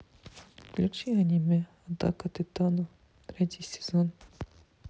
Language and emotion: Russian, sad